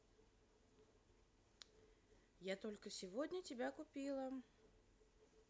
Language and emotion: Russian, neutral